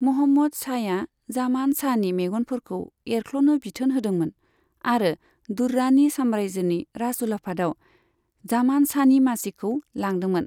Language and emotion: Bodo, neutral